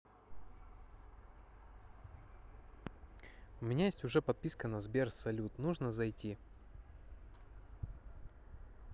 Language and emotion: Russian, neutral